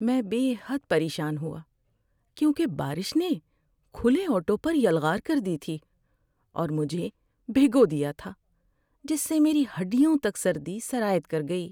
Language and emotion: Urdu, sad